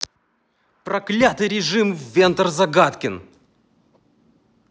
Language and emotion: Russian, angry